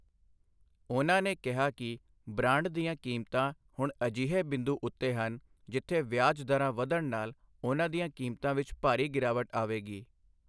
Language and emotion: Punjabi, neutral